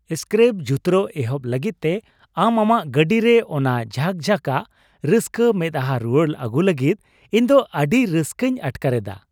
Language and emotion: Santali, happy